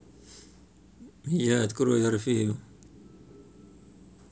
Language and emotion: Russian, neutral